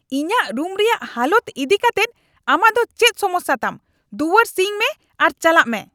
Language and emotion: Santali, angry